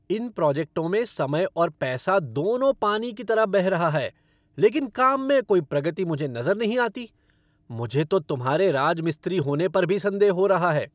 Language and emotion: Hindi, angry